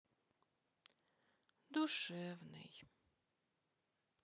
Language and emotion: Russian, sad